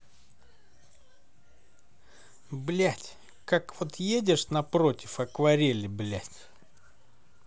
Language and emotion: Russian, angry